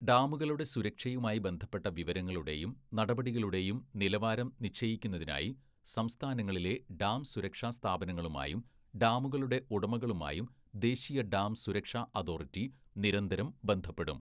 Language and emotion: Malayalam, neutral